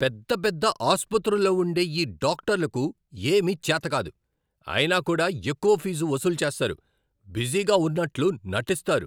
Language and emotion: Telugu, angry